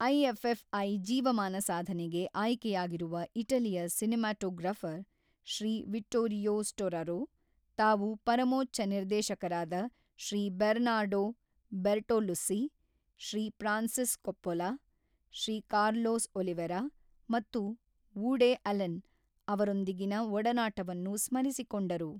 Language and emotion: Kannada, neutral